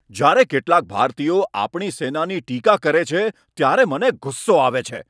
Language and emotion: Gujarati, angry